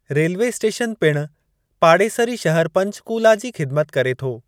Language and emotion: Sindhi, neutral